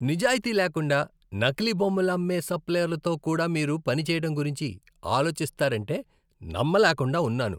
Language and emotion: Telugu, disgusted